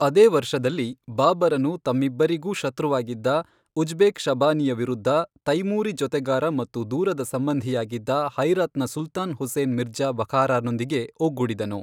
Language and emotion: Kannada, neutral